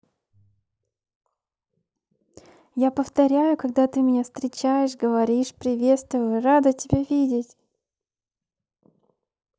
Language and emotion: Russian, positive